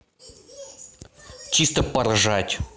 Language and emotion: Russian, angry